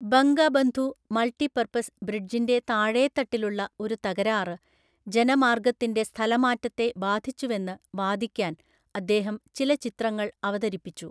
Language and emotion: Malayalam, neutral